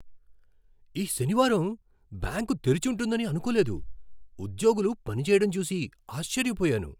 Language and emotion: Telugu, surprised